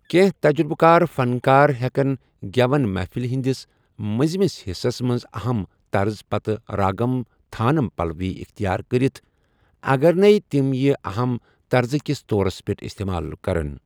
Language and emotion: Kashmiri, neutral